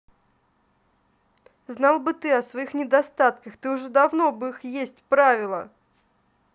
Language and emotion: Russian, angry